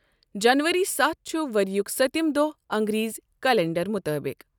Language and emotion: Kashmiri, neutral